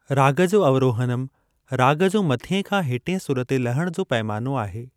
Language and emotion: Sindhi, neutral